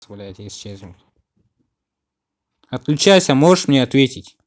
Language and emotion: Russian, angry